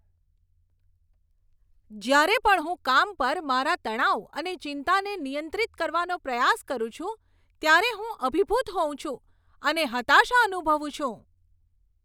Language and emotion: Gujarati, angry